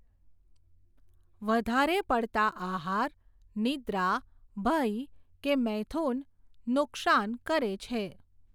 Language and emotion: Gujarati, neutral